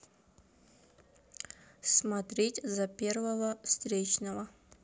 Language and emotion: Russian, neutral